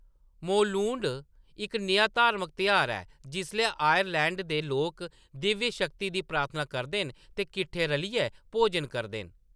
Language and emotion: Dogri, neutral